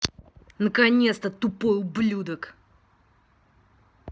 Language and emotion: Russian, angry